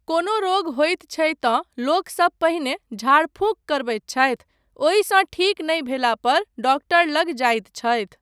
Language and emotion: Maithili, neutral